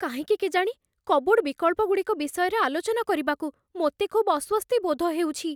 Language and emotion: Odia, fearful